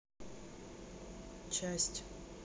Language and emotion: Russian, neutral